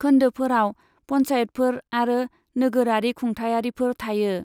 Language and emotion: Bodo, neutral